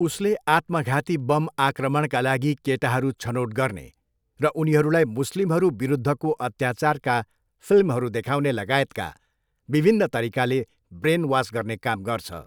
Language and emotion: Nepali, neutral